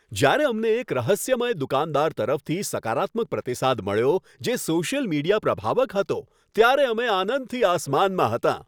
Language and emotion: Gujarati, happy